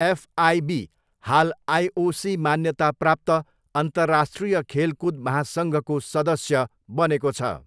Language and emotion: Nepali, neutral